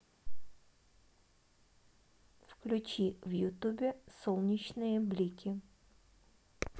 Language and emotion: Russian, neutral